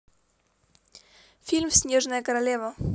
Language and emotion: Russian, positive